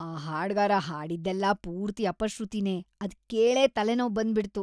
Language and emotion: Kannada, disgusted